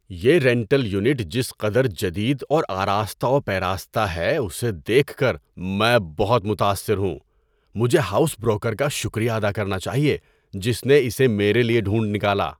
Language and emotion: Urdu, surprised